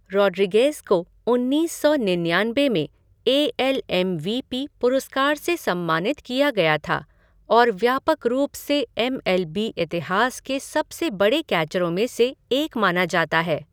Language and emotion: Hindi, neutral